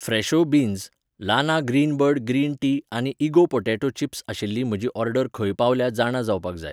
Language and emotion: Goan Konkani, neutral